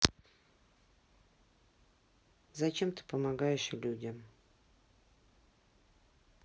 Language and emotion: Russian, sad